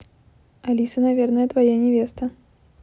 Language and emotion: Russian, neutral